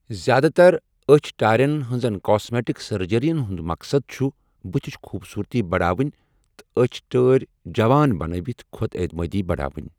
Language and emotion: Kashmiri, neutral